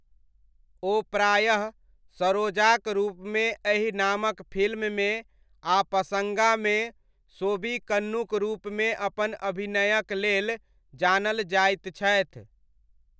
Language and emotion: Maithili, neutral